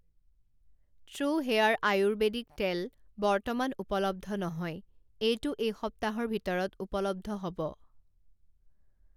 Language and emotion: Assamese, neutral